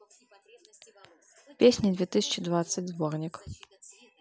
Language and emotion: Russian, neutral